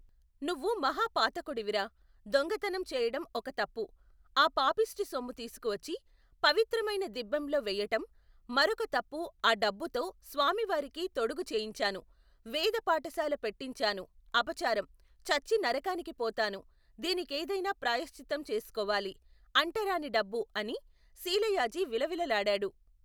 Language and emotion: Telugu, neutral